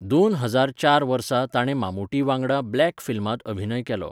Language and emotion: Goan Konkani, neutral